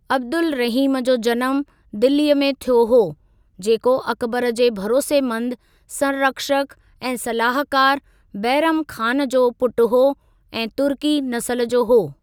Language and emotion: Sindhi, neutral